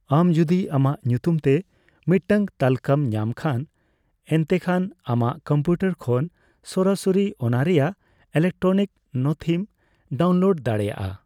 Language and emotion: Santali, neutral